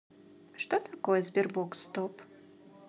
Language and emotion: Russian, positive